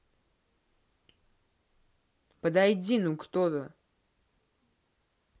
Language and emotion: Russian, angry